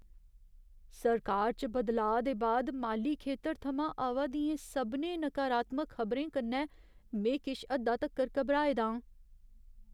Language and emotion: Dogri, fearful